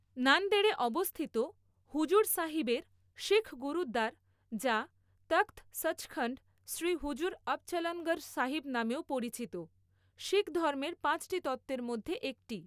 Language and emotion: Bengali, neutral